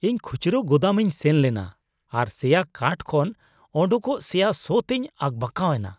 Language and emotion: Santali, disgusted